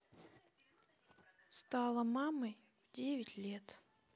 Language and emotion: Russian, neutral